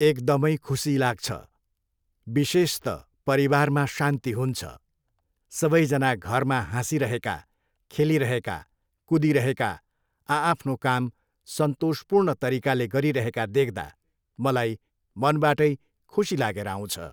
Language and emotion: Nepali, neutral